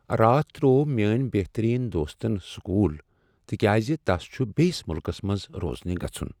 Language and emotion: Kashmiri, sad